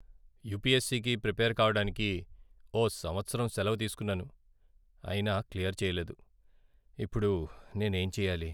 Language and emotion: Telugu, sad